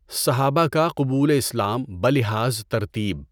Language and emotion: Urdu, neutral